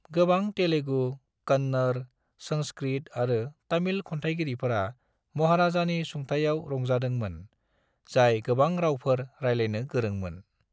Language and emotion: Bodo, neutral